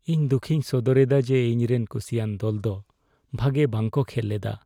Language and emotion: Santali, sad